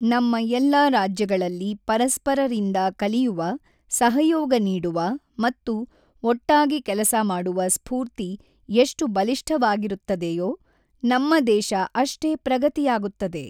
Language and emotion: Kannada, neutral